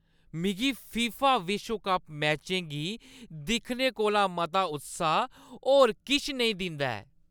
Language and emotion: Dogri, happy